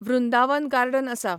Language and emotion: Goan Konkani, neutral